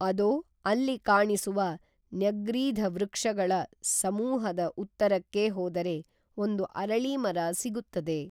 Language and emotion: Kannada, neutral